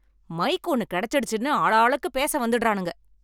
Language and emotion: Tamil, angry